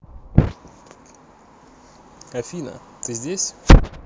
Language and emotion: Russian, neutral